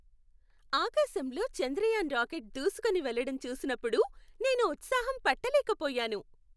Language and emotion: Telugu, happy